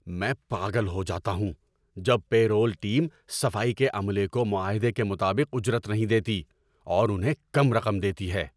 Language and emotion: Urdu, angry